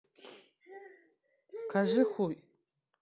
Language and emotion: Russian, neutral